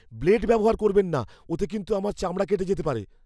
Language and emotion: Bengali, fearful